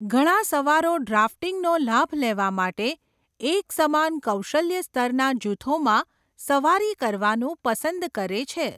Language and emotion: Gujarati, neutral